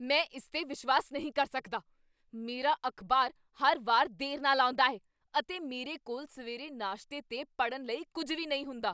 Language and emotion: Punjabi, angry